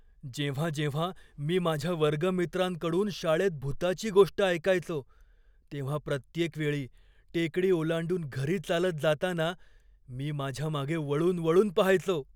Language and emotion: Marathi, fearful